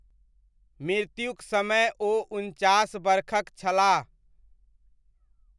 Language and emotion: Maithili, neutral